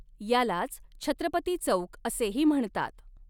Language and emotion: Marathi, neutral